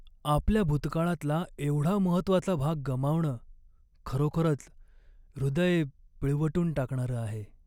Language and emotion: Marathi, sad